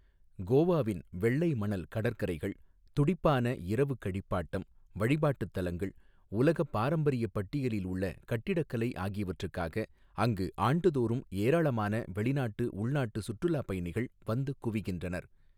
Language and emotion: Tamil, neutral